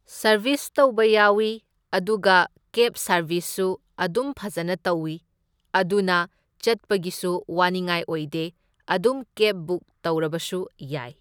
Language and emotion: Manipuri, neutral